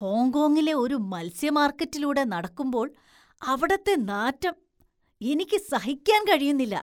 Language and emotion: Malayalam, disgusted